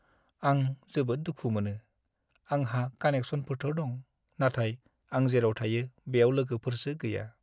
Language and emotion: Bodo, sad